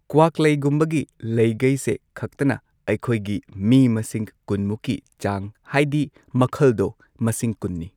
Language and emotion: Manipuri, neutral